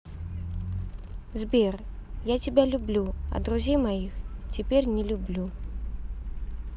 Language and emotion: Russian, neutral